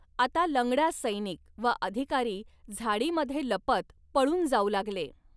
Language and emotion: Marathi, neutral